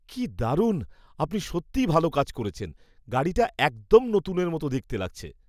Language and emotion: Bengali, surprised